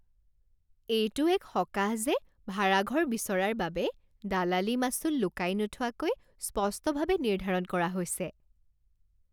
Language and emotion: Assamese, happy